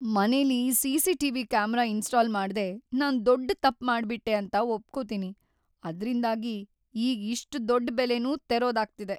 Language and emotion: Kannada, sad